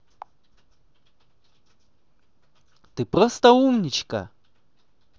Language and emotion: Russian, positive